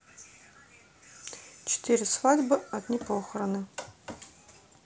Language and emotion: Russian, neutral